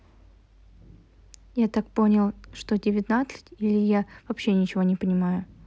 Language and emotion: Russian, neutral